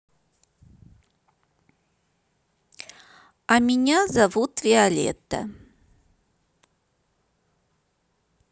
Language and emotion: Russian, neutral